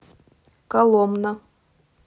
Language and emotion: Russian, neutral